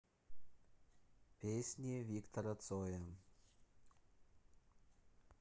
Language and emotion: Russian, neutral